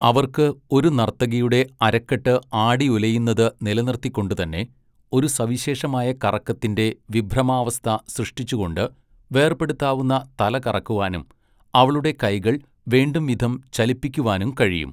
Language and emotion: Malayalam, neutral